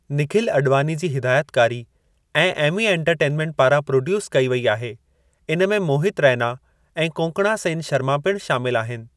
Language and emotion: Sindhi, neutral